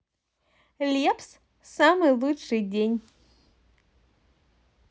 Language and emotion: Russian, positive